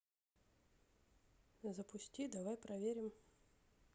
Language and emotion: Russian, neutral